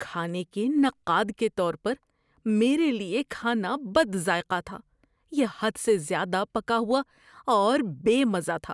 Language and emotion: Urdu, disgusted